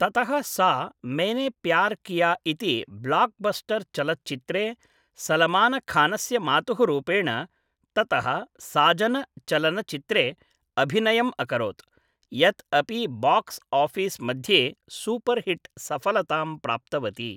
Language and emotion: Sanskrit, neutral